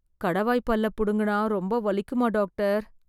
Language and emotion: Tamil, fearful